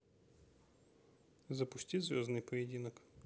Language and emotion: Russian, neutral